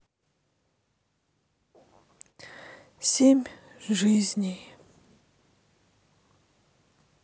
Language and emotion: Russian, sad